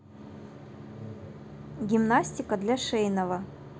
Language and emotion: Russian, neutral